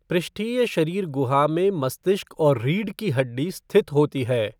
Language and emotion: Hindi, neutral